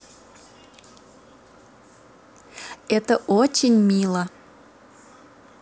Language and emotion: Russian, positive